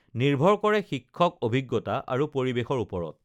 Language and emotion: Assamese, neutral